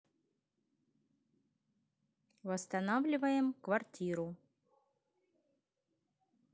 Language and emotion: Russian, neutral